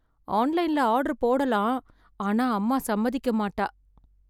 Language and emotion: Tamil, sad